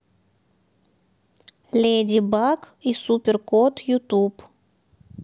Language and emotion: Russian, neutral